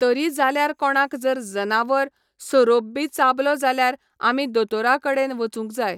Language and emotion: Goan Konkani, neutral